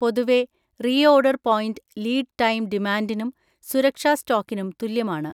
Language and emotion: Malayalam, neutral